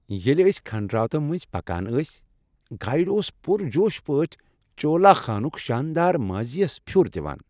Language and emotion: Kashmiri, happy